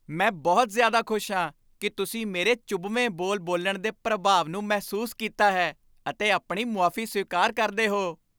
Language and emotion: Punjabi, happy